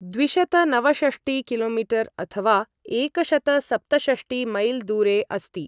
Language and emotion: Sanskrit, neutral